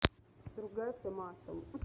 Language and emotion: Russian, neutral